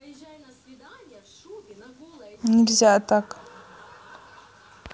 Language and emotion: Russian, neutral